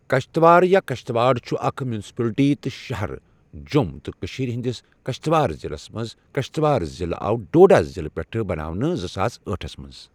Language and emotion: Kashmiri, neutral